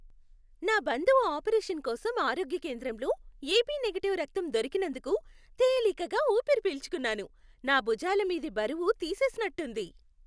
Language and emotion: Telugu, happy